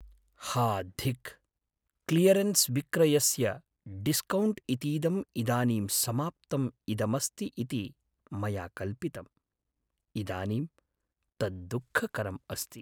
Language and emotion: Sanskrit, sad